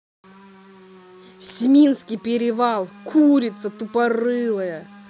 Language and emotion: Russian, angry